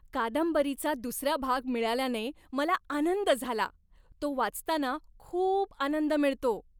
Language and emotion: Marathi, happy